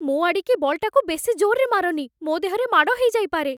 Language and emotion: Odia, fearful